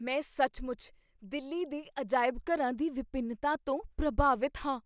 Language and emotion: Punjabi, surprised